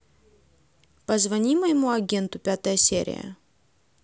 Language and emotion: Russian, neutral